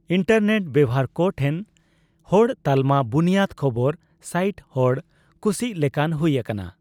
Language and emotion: Santali, neutral